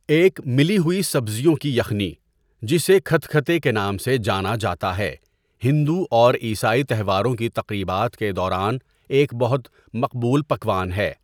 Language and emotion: Urdu, neutral